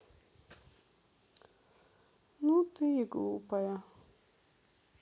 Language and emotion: Russian, sad